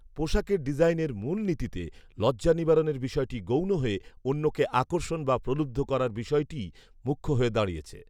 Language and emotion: Bengali, neutral